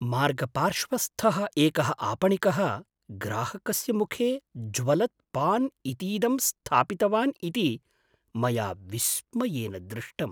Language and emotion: Sanskrit, surprised